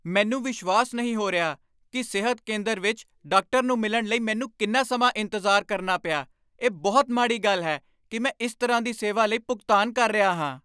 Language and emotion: Punjabi, angry